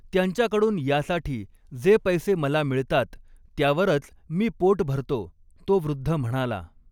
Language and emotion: Marathi, neutral